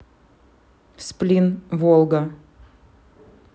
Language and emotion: Russian, neutral